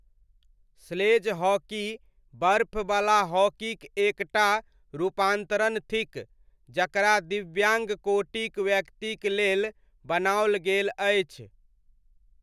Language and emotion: Maithili, neutral